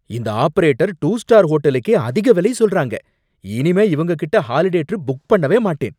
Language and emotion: Tamil, angry